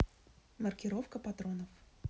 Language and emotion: Russian, neutral